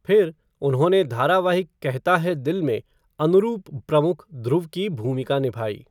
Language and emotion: Hindi, neutral